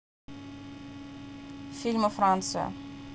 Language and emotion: Russian, neutral